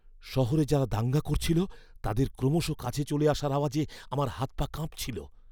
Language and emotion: Bengali, fearful